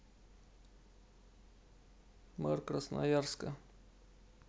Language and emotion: Russian, neutral